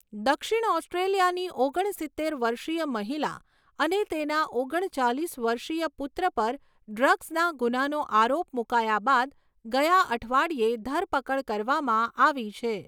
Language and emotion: Gujarati, neutral